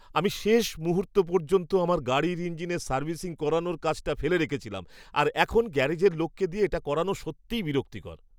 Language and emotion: Bengali, disgusted